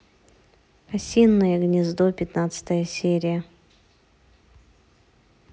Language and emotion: Russian, neutral